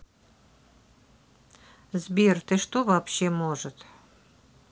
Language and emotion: Russian, neutral